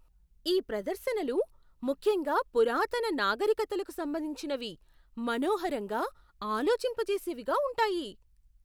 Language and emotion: Telugu, surprised